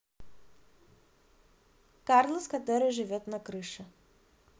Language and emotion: Russian, neutral